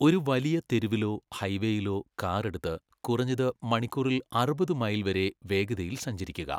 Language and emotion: Malayalam, neutral